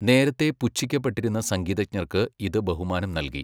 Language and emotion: Malayalam, neutral